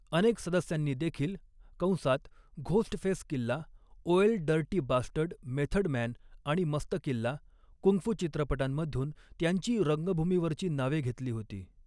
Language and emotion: Marathi, neutral